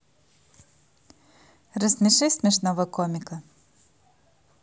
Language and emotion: Russian, positive